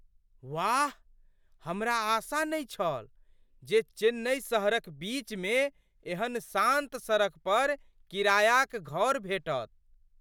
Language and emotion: Maithili, surprised